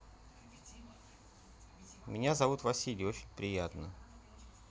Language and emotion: Russian, neutral